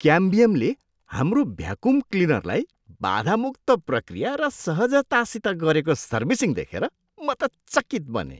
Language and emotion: Nepali, surprised